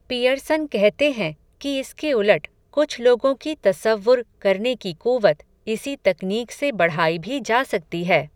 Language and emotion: Hindi, neutral